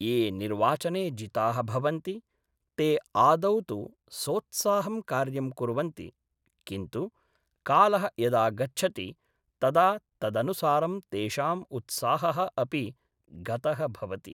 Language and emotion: Sanskrit, neutral